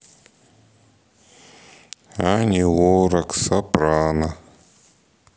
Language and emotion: Russian, sad